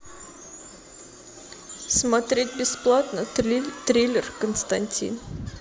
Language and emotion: Russian, sad